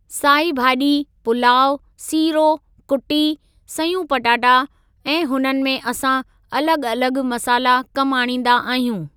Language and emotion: Sindhi, neutral